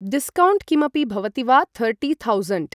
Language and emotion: Sanskrit, neutral